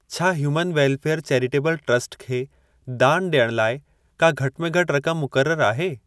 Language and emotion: Sindhi, neutral